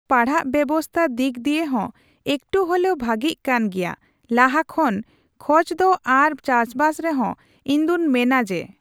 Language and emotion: Santali, neutral